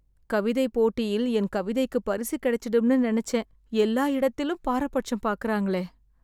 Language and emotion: Tamil, sad